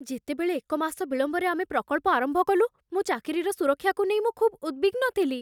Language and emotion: Odia, fearful